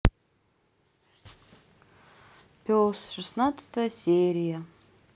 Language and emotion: Russian, sad